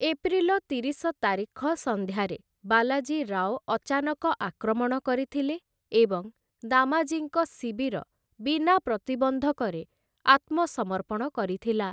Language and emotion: Odia, neutral